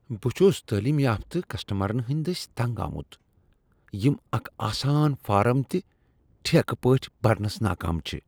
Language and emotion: Kashmiri, disgusted